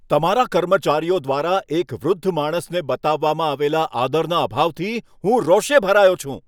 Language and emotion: Gujarati, angry